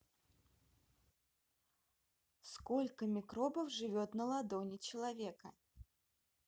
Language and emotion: Russian, neutral